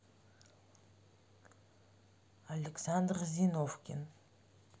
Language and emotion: Russian, neutral